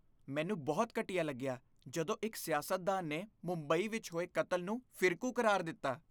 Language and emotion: Punjabi, disgusted